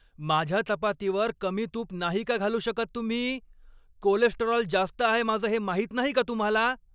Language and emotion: Marathi, angry